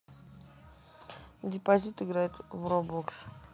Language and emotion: Russian, neutral